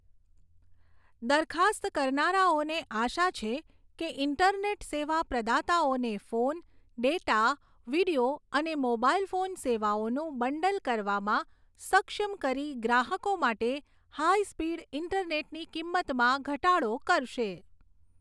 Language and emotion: Gujarati, neutral